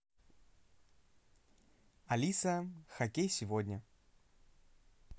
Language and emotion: Russian, positive